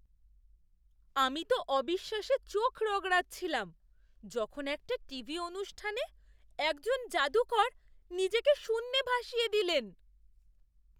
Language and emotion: Bengali, surprised